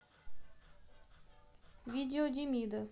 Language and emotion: Russian, neutral